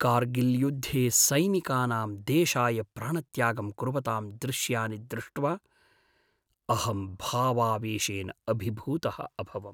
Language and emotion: Sanskrit, sad